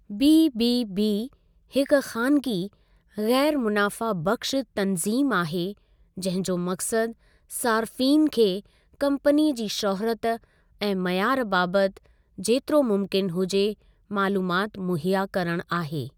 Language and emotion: Sindhi, neutral